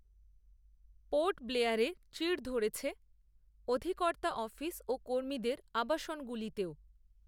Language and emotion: Bengali, neutral